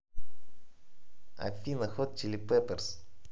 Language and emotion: Russian, neutral